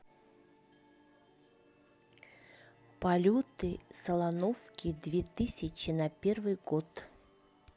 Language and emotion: Russian, neutral